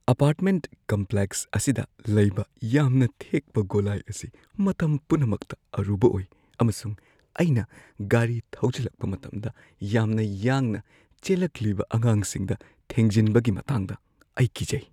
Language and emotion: Manipuri, fearful